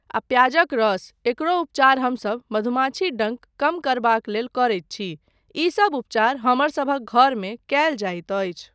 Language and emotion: Maithili, neutral